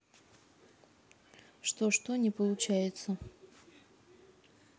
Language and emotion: Russian, neutral